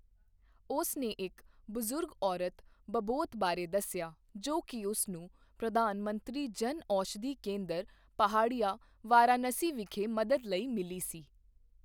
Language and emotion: Punjabi, neutral